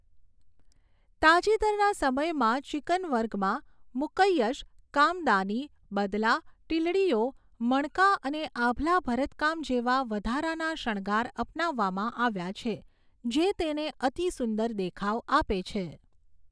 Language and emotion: Gujarati, neutral